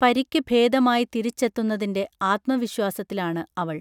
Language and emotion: Malayalam, neutral